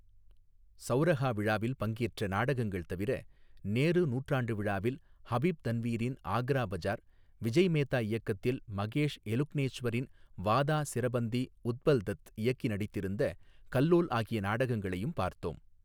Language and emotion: Tamil, neutral